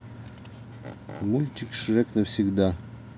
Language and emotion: Russian, neutral